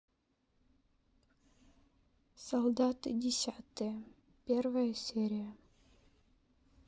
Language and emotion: Russian, sad